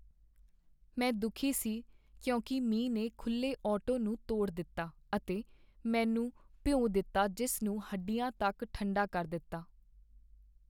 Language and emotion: Punjabi, sad